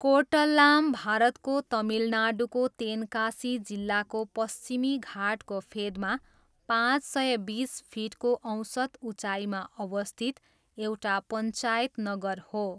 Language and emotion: Nepali, neutral